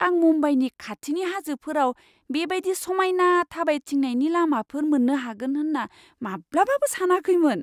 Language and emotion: Bodo, surprised